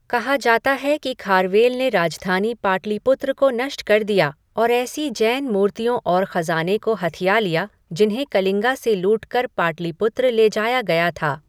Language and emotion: Hindi, neutral